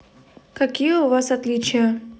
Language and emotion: Russian, neutral